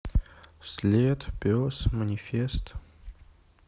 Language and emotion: Russian, neutral